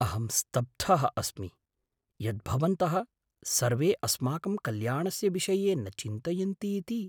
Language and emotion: Sanskrit, surprised